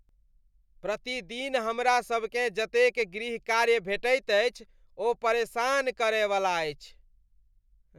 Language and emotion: Maithili, disgusted